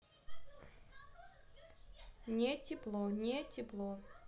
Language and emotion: Russian, neutral